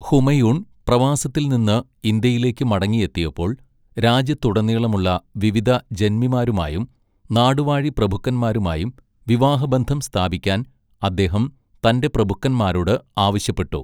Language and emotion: Malayalam, neutral